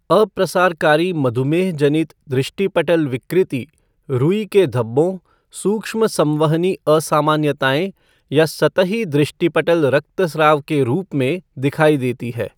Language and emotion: Hindi, neutral